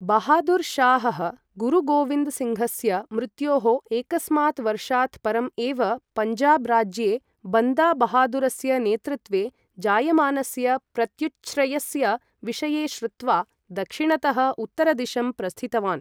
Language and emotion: Sanskrit, neutral